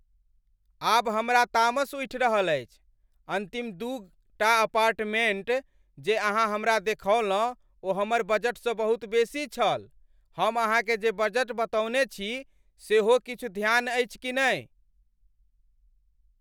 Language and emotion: Maithili, angry